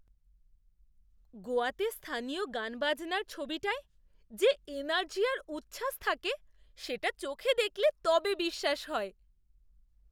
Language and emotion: Bengali, surprised